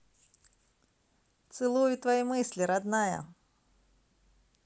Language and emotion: Russian, positive